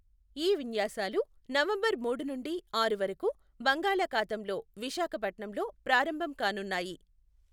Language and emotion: Telugu, neutral